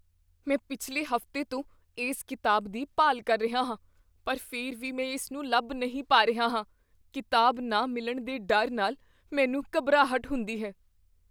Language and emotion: Punjabi, fearful